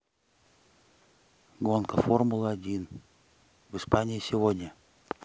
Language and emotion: Russian, neutral